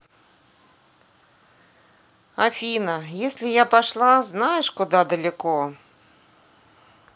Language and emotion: Russian, sad